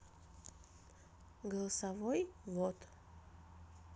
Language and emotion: Russian, neutral